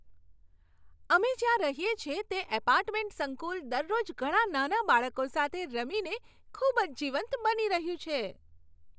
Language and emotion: Gujarati, happy